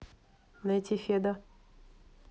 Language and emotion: Russian, neutral